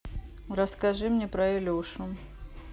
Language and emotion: Russian, neutral